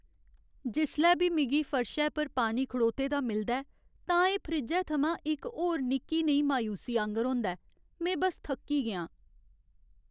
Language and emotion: Dogri, sad